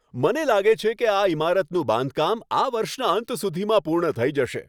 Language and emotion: Gujarati, happy